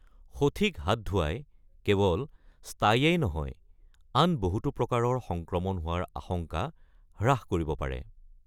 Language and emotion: Assamese, neutral